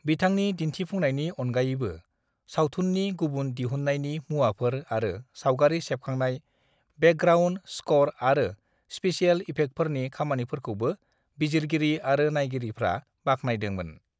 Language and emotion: Bodo, neutral